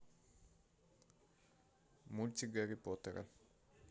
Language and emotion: Russian, neutral